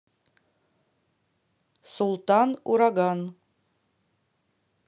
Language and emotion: Russian, neutral